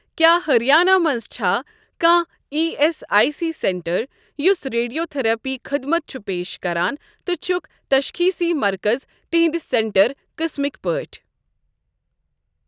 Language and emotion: Kashmiri, neutral